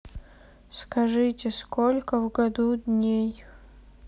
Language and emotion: Russian, sad